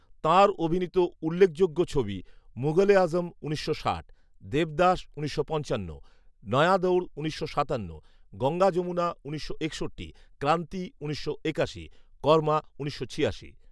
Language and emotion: Bengali, neutral